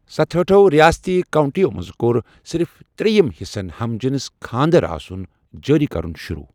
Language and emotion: Kashmiri, neutral